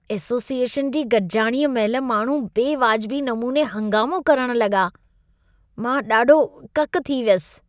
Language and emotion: Sindhi, disgusted